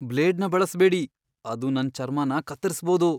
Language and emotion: Kannada, fearful